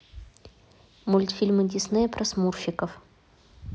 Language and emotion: Russian, neutral